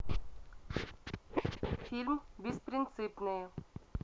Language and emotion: Russian, neutral